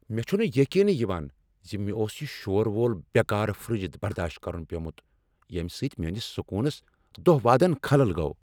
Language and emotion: Kashmiri, angry